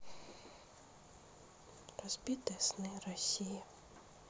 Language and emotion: Russian, sad